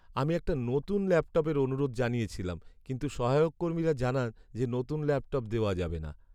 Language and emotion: Bengali, sad